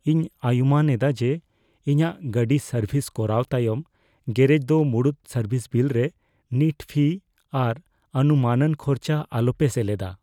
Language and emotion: Santali, fearful